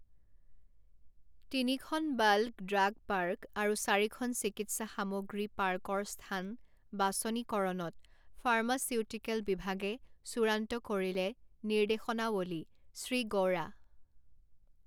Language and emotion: Assamese, neutral